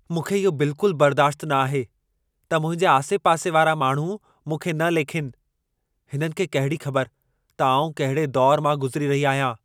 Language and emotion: Sindhi, angry